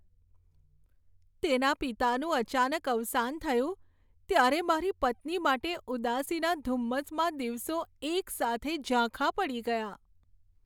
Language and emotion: Gujarati, sad